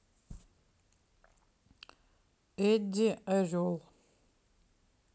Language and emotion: Russian, neutral